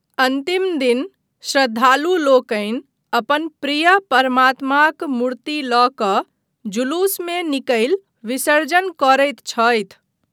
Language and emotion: Maithili, neutral